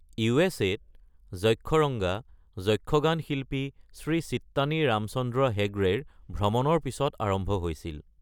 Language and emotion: Assamese, neutral